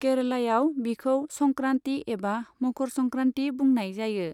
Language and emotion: Bodo, neutral